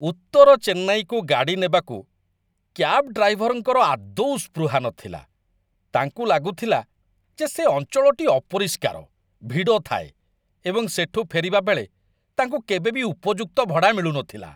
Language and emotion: Odia, disgusted